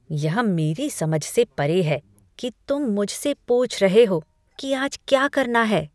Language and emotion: Hindi, disgusted